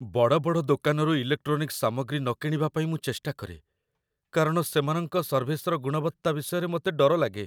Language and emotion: Odia, fearful